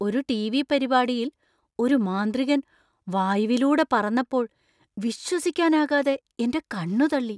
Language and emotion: Malayalam, surprised